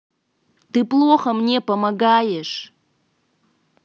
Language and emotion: Russian, angry